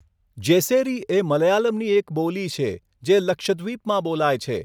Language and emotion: Gujarati, neutral